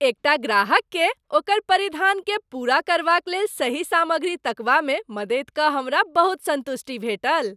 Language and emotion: Maithili, happy